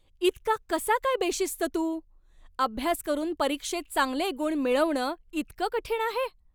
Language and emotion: Marathi, angry